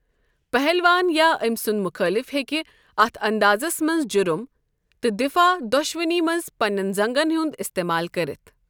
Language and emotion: Kashmiri, neutral